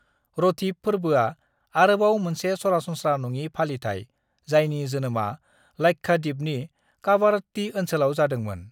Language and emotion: Bodo, neutral